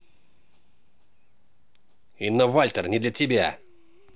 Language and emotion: Russian, angry